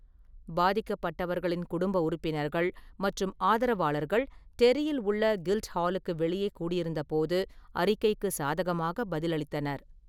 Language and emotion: Tamil, neutral